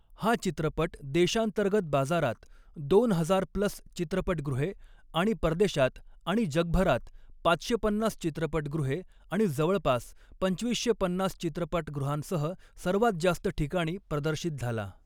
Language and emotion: Marathi, neutral